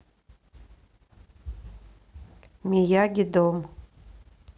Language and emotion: Russian, neutral